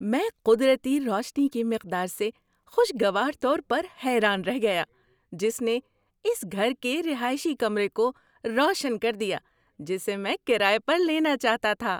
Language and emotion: Urdu, surprised